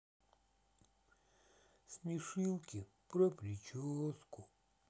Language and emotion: Russian, sad